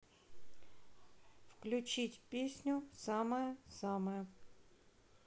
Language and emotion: Russian, neutral